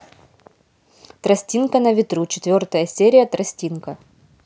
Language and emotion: Russian, neutral